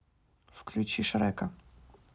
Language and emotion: Russian, neutral